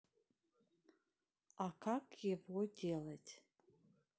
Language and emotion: Russian, neutral